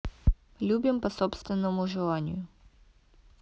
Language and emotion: Russian, neutral